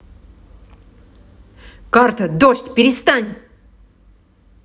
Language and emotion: Russian, angry